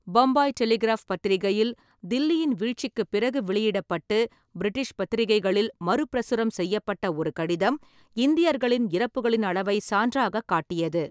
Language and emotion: Tamil, neutral